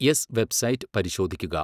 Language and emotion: Malayalam, neutral